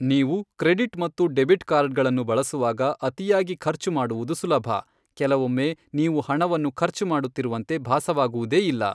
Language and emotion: Kannada, neutral